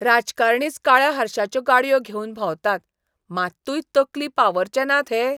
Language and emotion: Goan Konkani, disgusted